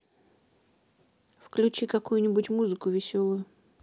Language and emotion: Russian, neutral